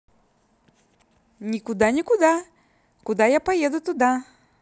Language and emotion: Russian, positive